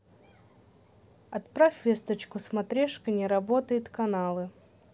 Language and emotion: Russian, neutral